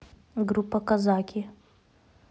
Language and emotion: Russian, neutral